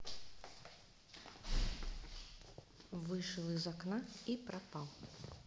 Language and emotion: Russian, neutral